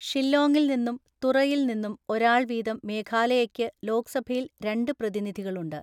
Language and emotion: Malayalam, neutral